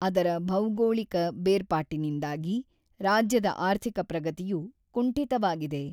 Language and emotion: Kannada, neutral